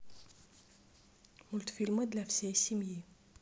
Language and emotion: Russian, neutral